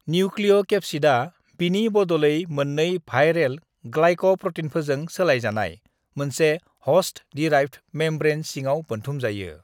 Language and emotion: Bodo, neutral